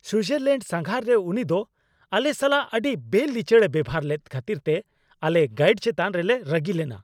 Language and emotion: Santali, angry